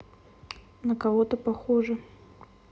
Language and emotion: Russian, neutral